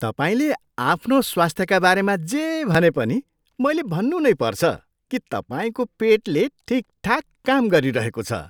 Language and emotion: Nepali, surprised